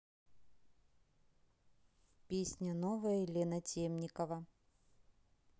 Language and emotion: Russian, neutral